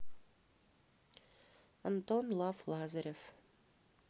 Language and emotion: Russian, neutral